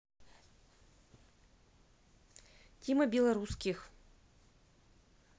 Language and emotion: Russian, neutral